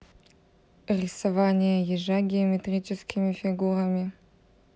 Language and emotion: Russian, neutral